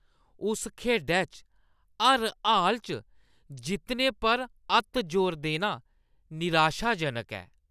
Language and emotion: Dogri, disgusted